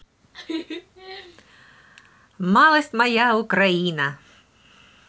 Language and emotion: Russian, positive